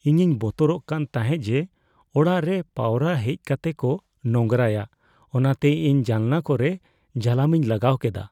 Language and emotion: Santali, fearful